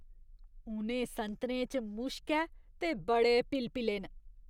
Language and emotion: Dogri, disgusted